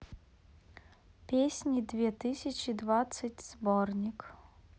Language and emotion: Russian, neutral